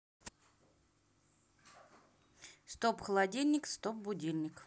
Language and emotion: Russian, neutral